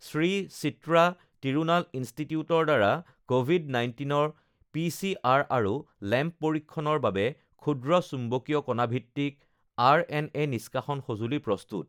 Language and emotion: Assamese, neutral